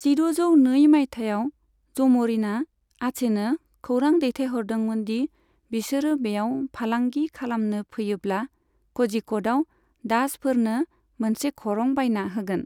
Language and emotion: Bodo, neutral